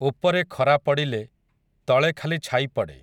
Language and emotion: Odia, neutral